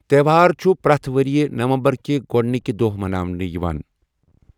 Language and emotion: Kashmiri, neutral